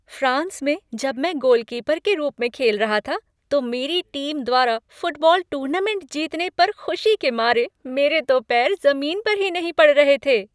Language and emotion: Hindi, happy